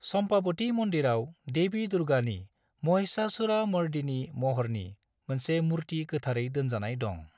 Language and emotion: Bodo, neutral